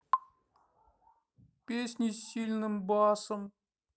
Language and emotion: Russian, sad